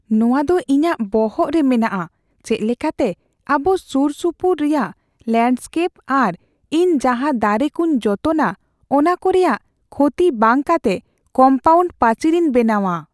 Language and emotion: Santali, fearful